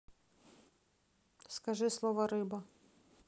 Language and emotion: Russian, neutral